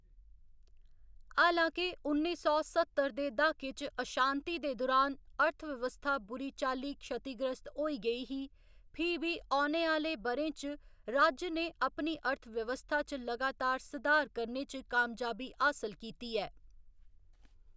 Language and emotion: Dogri, neutral